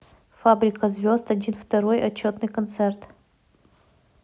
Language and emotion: Russian, neutral